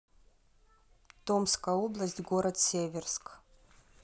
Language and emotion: Russian, neutral